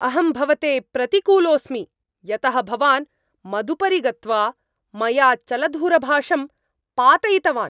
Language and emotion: Sanskrit, angry